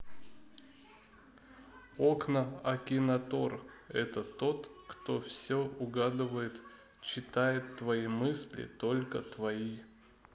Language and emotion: Russian, neutral